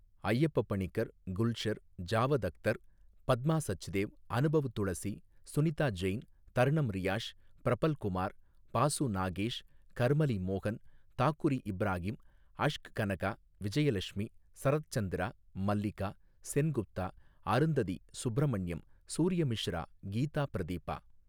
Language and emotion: Tamil, neutral